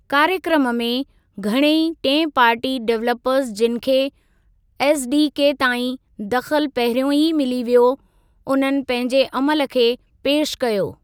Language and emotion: Sindhi, neutral